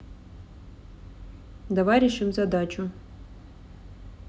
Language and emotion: Russian, neutral